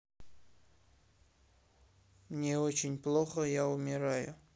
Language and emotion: Russian, sad